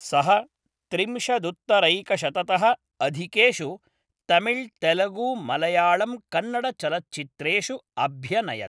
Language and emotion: Sanskrit, neutral